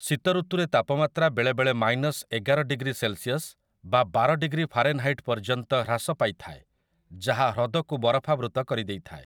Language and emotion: Odia, neutral